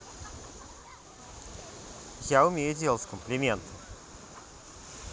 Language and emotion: Russian, neutral